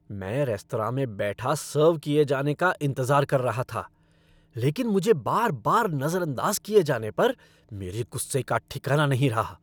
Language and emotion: Hindi, angry